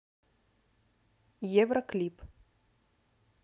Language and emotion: Russian, neutral